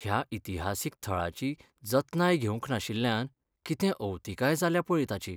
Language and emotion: Goan Konkani, sad